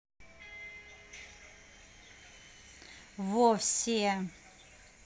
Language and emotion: Russian, neutral